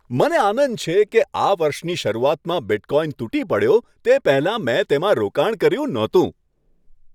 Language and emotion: Gujarati, happy